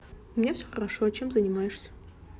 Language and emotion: Russian, neutral